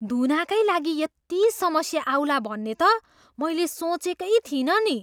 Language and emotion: Nepali, surprised